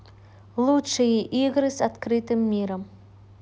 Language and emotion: Russian, neutral